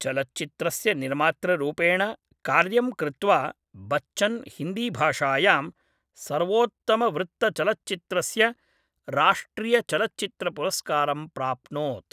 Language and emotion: Sanskrit, neutral